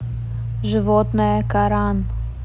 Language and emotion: Russian, neutral